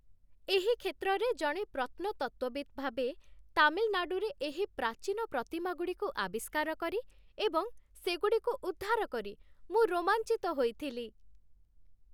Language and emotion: Odia, happy